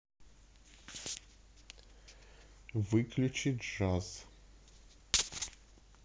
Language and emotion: Russian, neutral